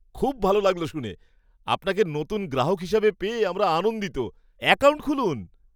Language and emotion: Bengali, surprised